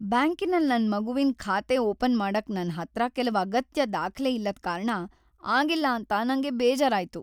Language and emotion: Kannada, sad